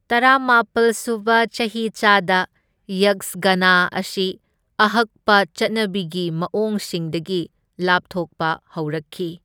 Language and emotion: Manipuri, neutral